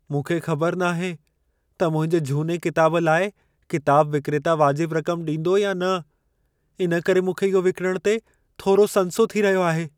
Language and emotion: Sindhi, fearful